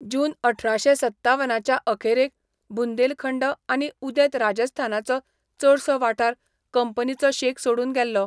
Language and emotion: Goan Konkani, neutral